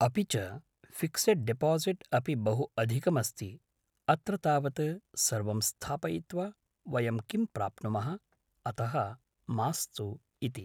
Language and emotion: Sanskrit, neutral